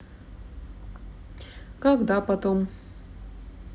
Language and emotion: Russian, neutral